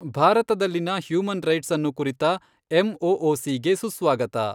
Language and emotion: Kannada, neutral